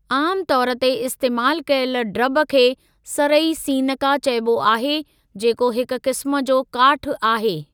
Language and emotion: Sindhi, neutral